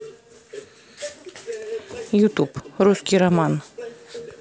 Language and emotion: Russian, neutral